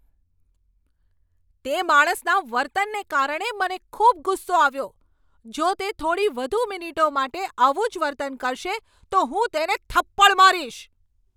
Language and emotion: Gujarati, angry